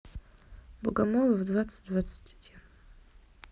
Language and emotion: Russian, neutral